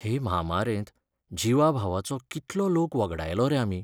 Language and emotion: Goan Konkani, sad